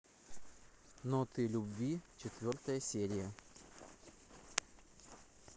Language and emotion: Russian, neutral